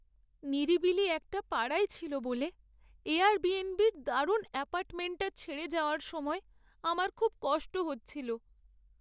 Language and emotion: Bengali, sad